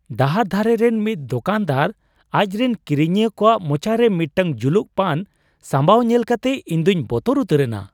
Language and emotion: Santali, surprised